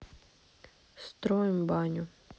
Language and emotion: Russian, neutral